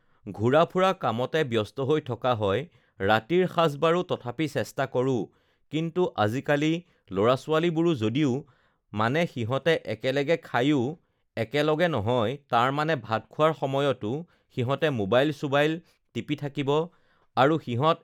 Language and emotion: Assamese, neutral